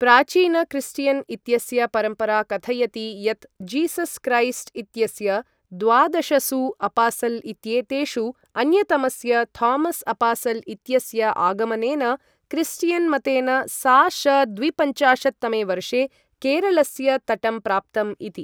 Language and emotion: Sanskrit, neutral